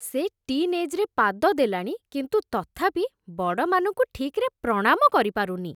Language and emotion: Odia, disgusted